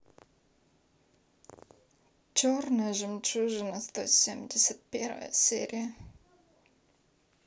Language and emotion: Russian, sad